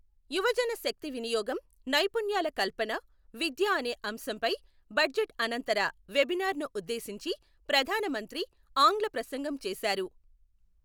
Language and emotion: Telugu, neutral